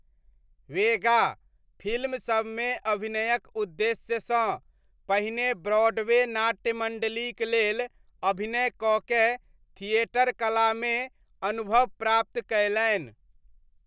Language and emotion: Maithili, neutral